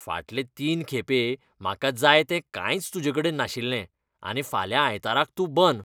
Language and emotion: Goan Konkani, disgusted